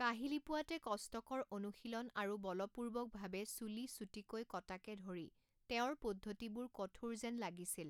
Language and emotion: Assamese, neutral